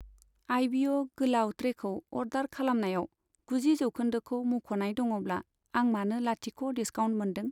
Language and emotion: Bodo, neutral